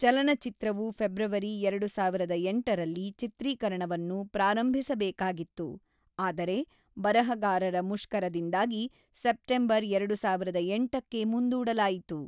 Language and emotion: Kannada, neutral